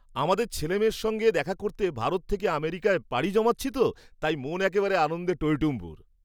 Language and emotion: Bengali, happy